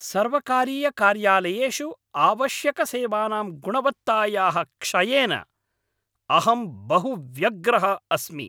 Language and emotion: Sanskrit, angry